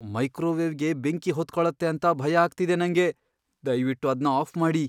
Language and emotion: Kannada, fearful